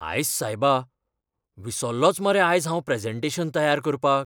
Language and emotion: Goan Konkani, fearful